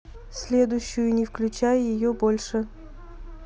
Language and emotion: Russian, neutral